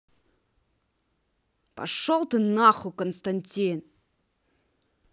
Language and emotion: Russian, angry